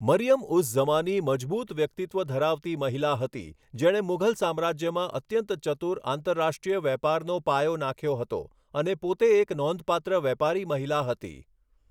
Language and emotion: Gujarati, neutral